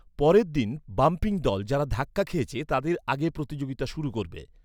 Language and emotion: Bengali, neutral